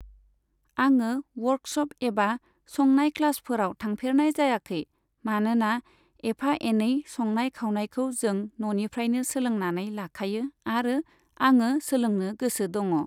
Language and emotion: Bodo, neutral